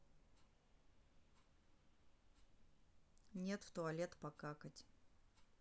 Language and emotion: Russian, neutral